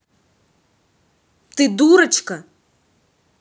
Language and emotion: Russian, angry